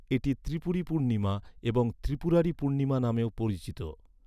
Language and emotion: Bengali, neutral